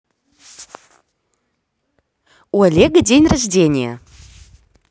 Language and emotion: Russian, positive